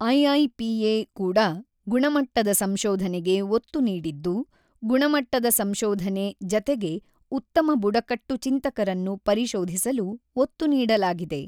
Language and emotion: Kannada, neutral